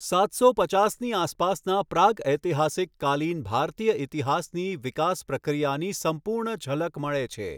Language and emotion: Gujarati, neutral